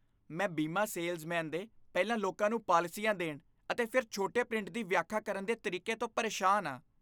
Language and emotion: Punjabi, disgusted